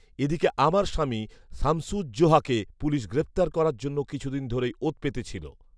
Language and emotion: Bengali, neutral